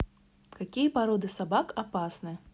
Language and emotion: Russian, neutral